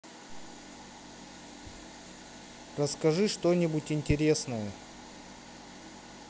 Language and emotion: Russian, neutral